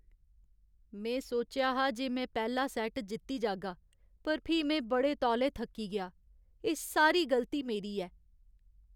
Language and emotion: Dogri, sad